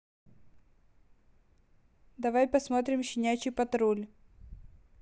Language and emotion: Russian, neutral